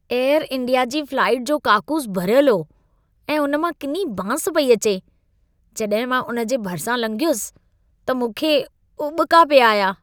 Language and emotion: Sindhi, disgusted